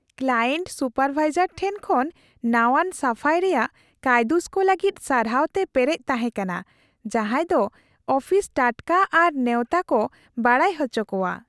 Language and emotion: Santali, happy